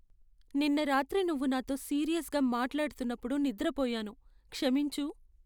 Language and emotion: Telugu, sad